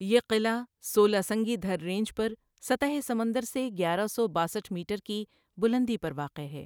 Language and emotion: Urdu, neutral